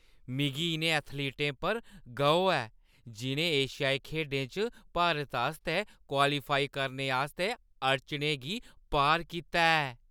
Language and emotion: Dogri, happy